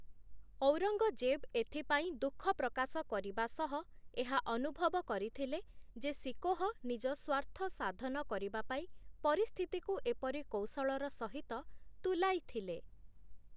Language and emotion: Odia, neutral